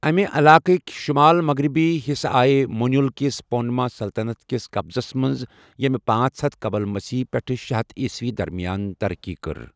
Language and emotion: Kashmiri, neutral